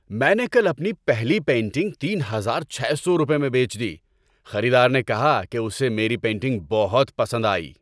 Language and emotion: Urdu, happy